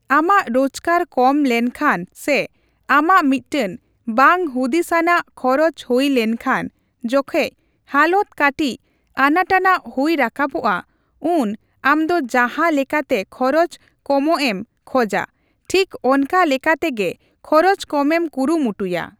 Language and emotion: Santali, neutral